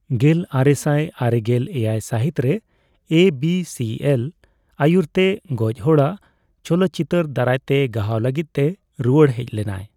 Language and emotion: Santali, neutral